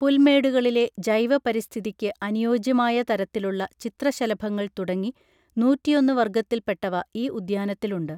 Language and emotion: Malayalam, neutral